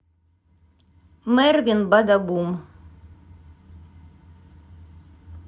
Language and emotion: Russian, neutral